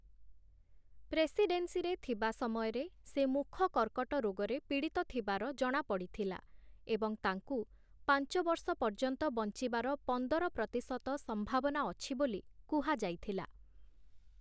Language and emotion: Odia, neutral